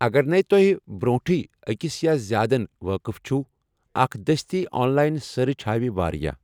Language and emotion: Kashmiri, neutral